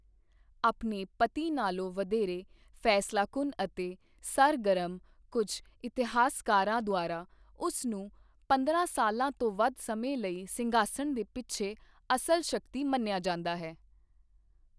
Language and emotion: Punjabi, neutral